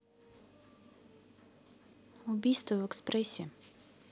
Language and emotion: Russian, neutral